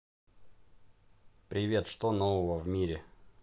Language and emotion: Russian, positive